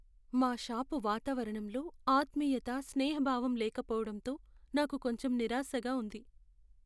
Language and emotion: Telugu, sad